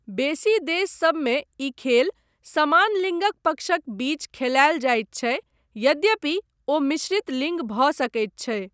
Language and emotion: Maithili, neutral